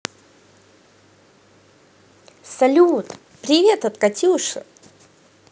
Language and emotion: Russian, positive